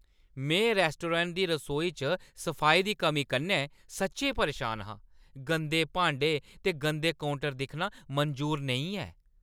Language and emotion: Dogri, angry